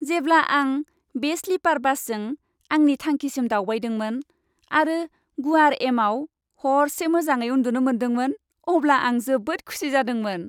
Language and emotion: Bodo, happy